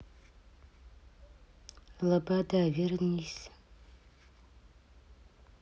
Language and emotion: Russian, neutral